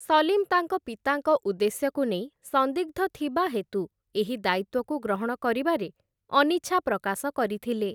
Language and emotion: Odia, neutral